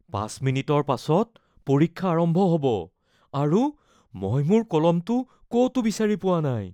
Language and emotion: Assamese, fearful